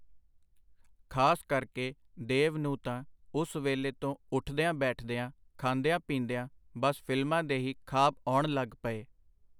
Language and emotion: Punjabi, neutral